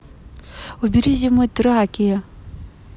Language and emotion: Russian, neutral